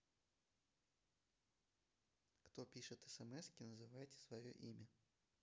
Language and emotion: Russian, neutral